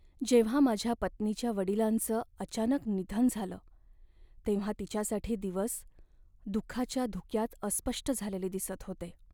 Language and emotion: Marathi, sad